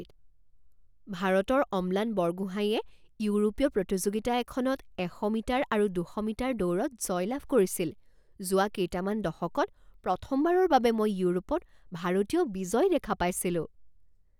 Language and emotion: Assamese, surprised